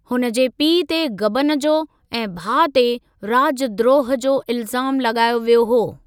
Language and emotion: Sindhi, neutral